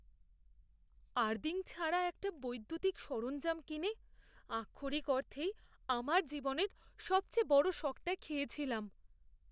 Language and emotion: Bengali, fearful